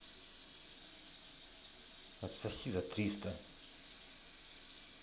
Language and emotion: Russian, angry